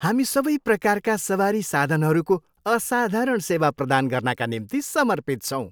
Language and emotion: Nepali, happy